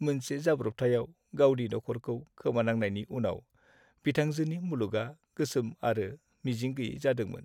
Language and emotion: Bodo, sad